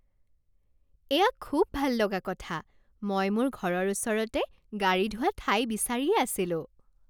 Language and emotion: Assamese, happy